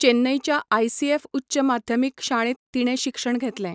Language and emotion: Goan Konkani, neutral